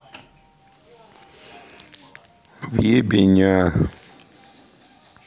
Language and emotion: Russian, sad